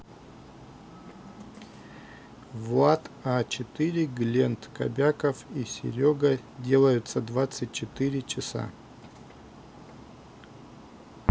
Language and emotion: Russian, neutral